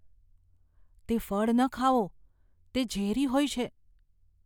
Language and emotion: Gujarati, fearful